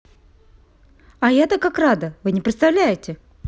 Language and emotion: Russian, positive